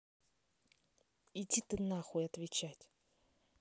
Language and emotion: Russian, angry